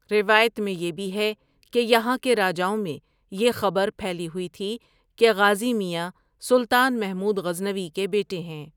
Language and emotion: Urdu, neutral